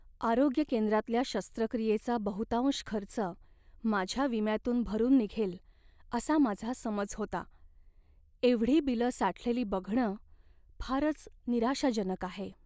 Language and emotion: Marathi, sad